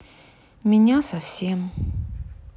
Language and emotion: Russian, sad